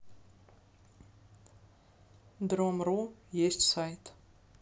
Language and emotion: Russian, neutral